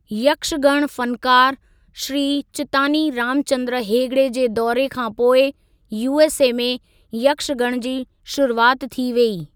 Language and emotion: Sindhi, neutral